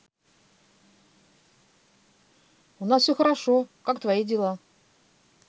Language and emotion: Russian, positive